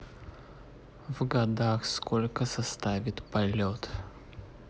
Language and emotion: Russian, neutral